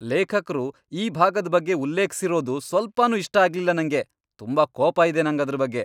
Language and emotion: Kannada, angry